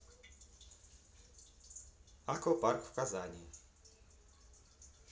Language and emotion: Russian, neutral